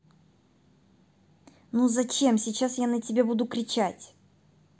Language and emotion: Russian, angry